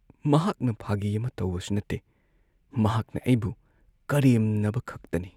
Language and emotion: Manipuri, sad